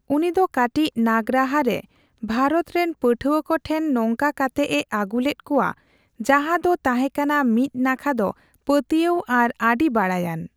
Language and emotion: Santali, neutral